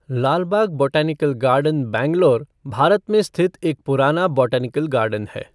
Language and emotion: Hindi, neutral